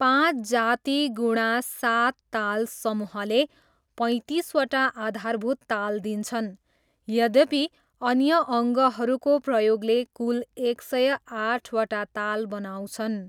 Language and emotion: Nepali, neutral